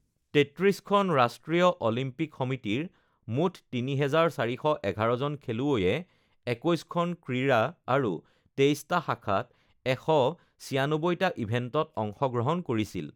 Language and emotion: Assamese, neutral